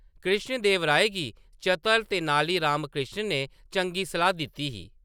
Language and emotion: Dogri, neutral